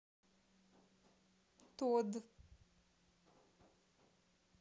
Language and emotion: Russian, sad